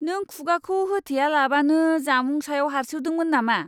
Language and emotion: Bodo, disgusted